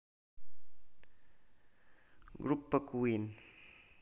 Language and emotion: Russian, neutral